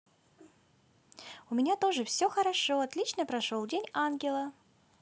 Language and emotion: Russian, positive